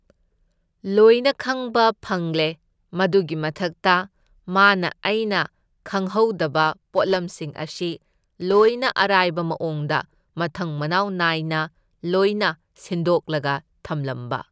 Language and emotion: Manipuri, neutral